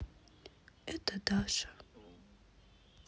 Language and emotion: Russian, sad